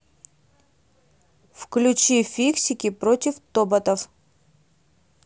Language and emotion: Russian, neutral